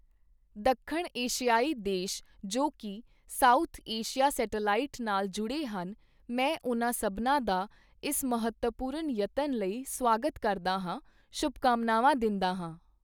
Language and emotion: Punjabi, neutral